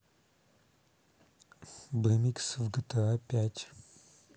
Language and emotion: Russian, neutral